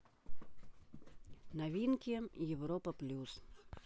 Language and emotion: Russian, neutral